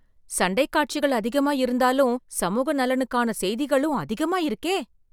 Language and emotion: Tamil, surprised